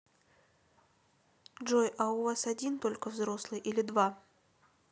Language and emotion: Russian, neutral